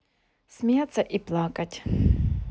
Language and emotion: Russian, neutral